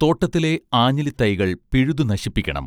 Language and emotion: Malayalam, neutral